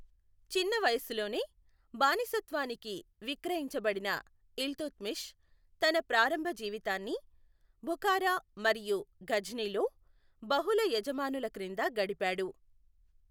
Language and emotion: Telugu, neutral